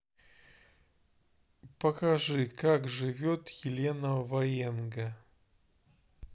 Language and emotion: Russian, neutral